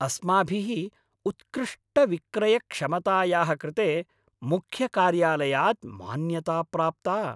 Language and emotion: Sanskrit, happy